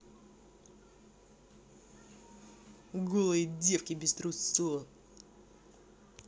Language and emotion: Russian, angry